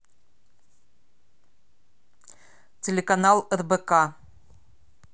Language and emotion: Russian, neutral